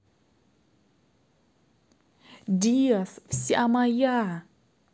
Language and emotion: Russian, positive